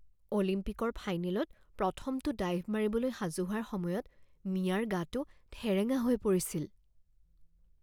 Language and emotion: Assamese, fearful